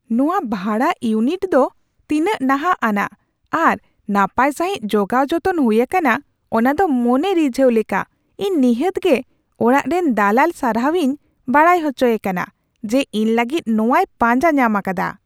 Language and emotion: Santali, surprised